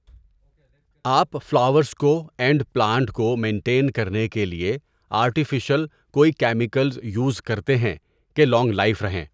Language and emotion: Urdu, neutral